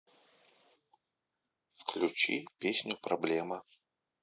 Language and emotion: Russian, neutral